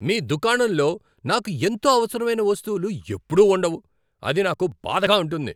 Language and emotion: Telugu, angry